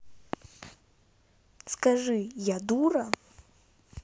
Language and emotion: Russian, neutral